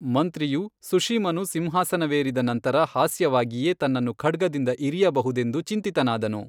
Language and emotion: Kannada, neutral